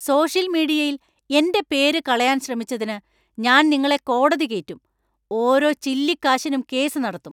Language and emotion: Malayalam, angry